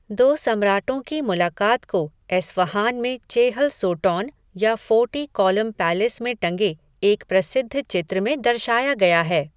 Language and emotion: Hindi, neutral